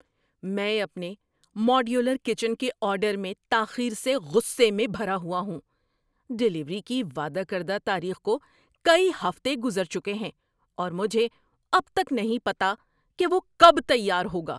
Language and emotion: Urdu, angry